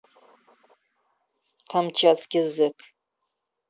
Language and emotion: Russian, angry